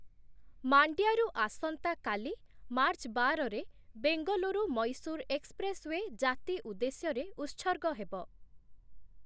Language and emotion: Odia, neutral